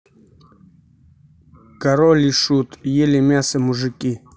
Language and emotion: Russian, neutral